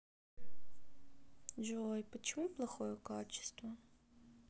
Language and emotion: Russian, sad